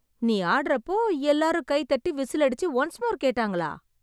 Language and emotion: Tamil, surprised